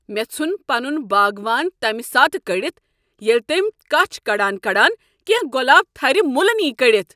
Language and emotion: Kashmiri, angry